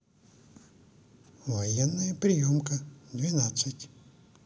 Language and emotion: Russian, neutral